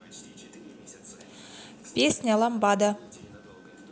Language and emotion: Russian, positive